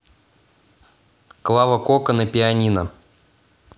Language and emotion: Russian, neutral